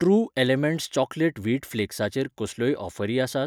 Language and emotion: Goan Konkani, neutral